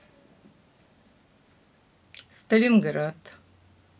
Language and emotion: Russian, neutral